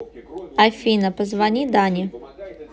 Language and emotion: Russian, neutral